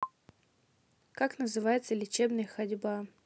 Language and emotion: Russian, neutral